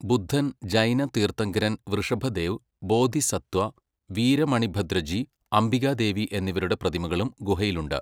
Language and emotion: Malayalam, neutral